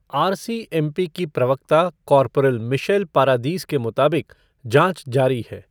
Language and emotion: Hindi, neutral